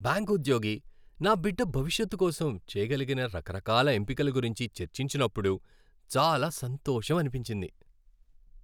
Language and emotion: Telugu, happy